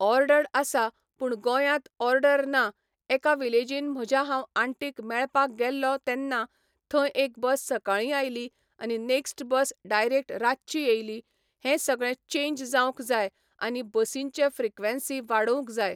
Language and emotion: Goan Konkani, neutral